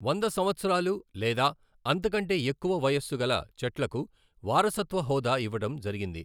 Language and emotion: Telugu, neutral